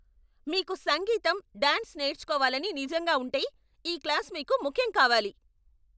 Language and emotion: Telugu, angry